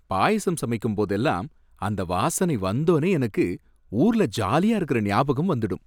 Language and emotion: Tamil, happy